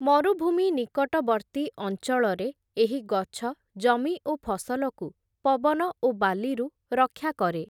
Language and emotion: Odia, neutral